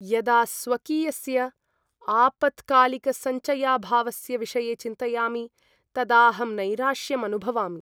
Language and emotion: Sanskrit, sad